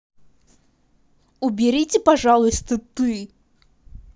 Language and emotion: Russian, angry